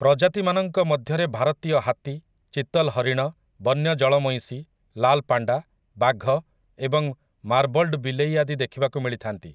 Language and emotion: Odia, neutral